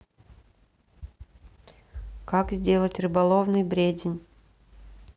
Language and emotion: Russian, neutral